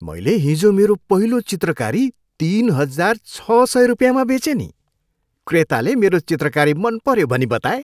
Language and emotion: Nepali, happy